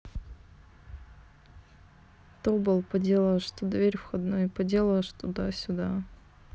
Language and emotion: Russian, sad